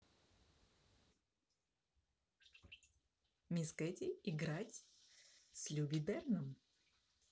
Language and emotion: Russian, positive